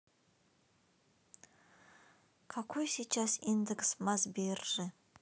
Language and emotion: Russian, sad